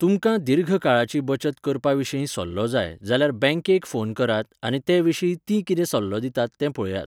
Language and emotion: Goan Konkani, neutral